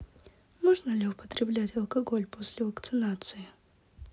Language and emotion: Russian, neutral